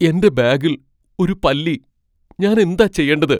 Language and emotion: Malayalam, fearful